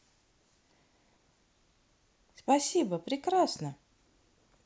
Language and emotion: Russian, positive